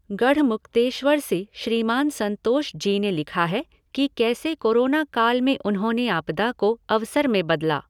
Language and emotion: Hindi, neutral